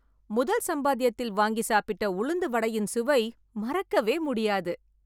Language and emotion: Tamil, happy